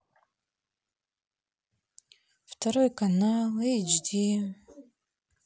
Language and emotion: Russian, sad